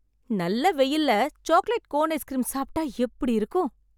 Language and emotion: Tamil, happy